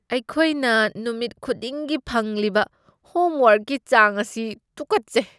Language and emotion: Manipuri, disgusted